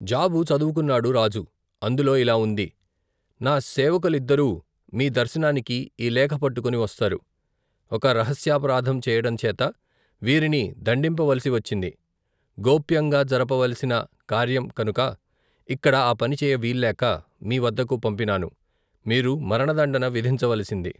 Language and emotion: Telugu, neutral